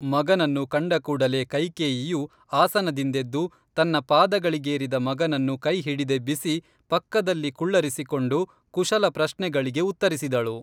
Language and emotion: Kannada, neutral